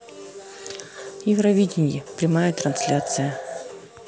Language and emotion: Russian, neutral